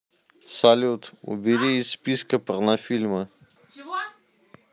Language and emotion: Russian, neutral